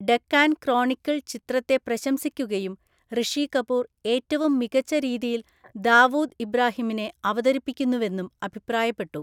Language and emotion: Malayalam, neutral